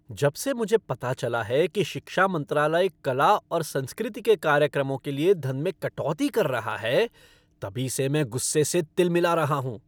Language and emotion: Hindi, angry